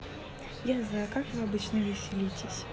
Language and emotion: Russian, neutral